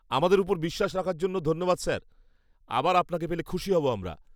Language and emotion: Bengali, happy